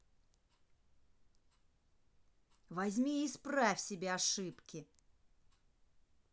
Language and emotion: Russian, angry